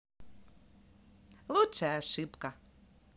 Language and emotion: Russian, positive